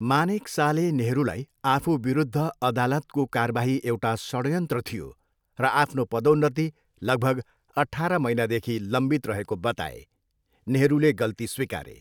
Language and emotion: Nepali, neutral